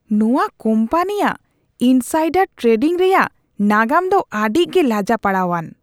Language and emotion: Santali, disgusted